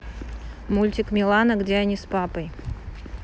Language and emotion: Russian, neutral